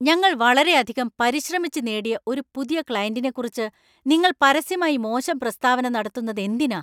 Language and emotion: Malayalam, angry